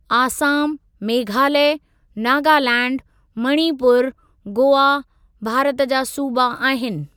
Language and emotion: Sindhi, neutral